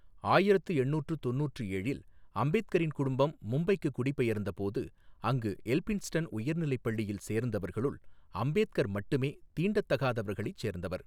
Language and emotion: Tamil, neutral